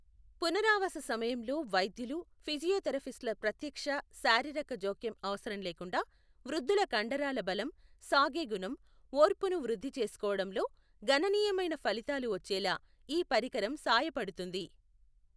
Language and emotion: Telugu, neutral